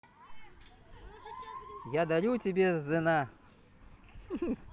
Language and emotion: Russian, positive